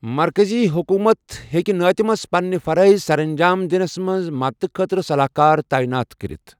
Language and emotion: Kashmiri, neutral